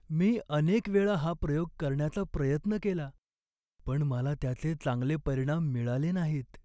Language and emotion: Marathi, sad